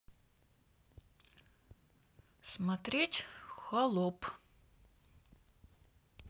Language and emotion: Russian, neutral